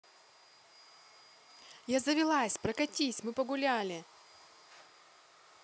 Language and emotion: Russian, positive